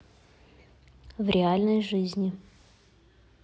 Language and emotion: Russian, neutral